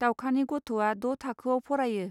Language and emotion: Bodo, neutral